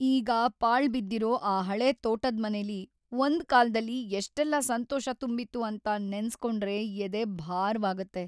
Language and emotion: Kannada, sad